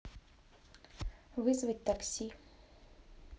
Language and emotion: Russian, neutral